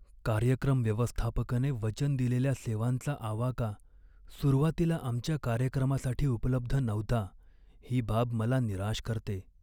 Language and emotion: Marathi, sad